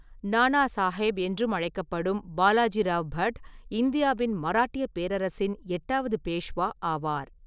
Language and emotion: Tamil, neutral